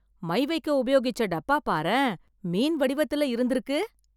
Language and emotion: Tamil, surprised